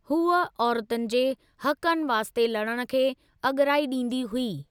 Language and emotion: Sindhi, neutral